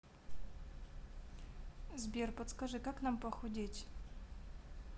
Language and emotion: Russian, neutral